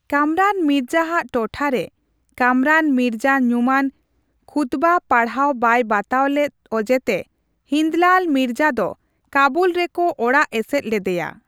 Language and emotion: Santali, neutral